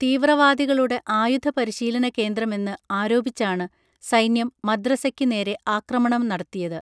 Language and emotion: Malayalam, neutral